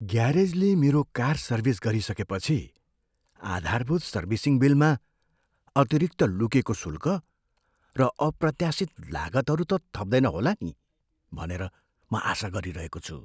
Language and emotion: Nepali, fearful